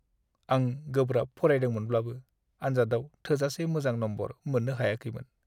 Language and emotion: Bodo, sad